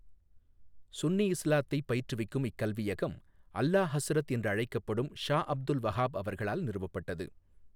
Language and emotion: Tamil, neutral